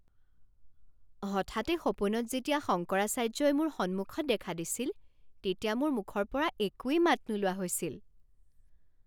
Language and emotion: Assamese, surprised